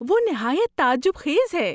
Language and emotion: Urdu, surprised